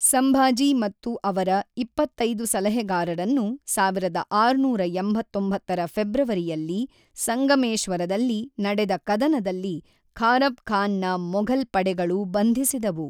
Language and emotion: Kannada, neutral